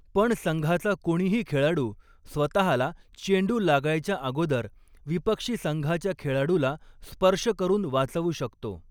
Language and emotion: Marathi, neutral